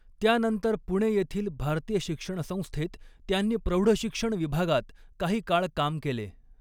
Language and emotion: Marathi, neutral